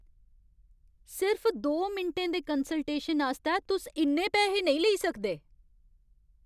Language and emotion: Dogri, angry